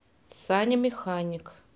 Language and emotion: Russian, neutral